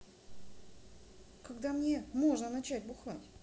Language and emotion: Russian, neutral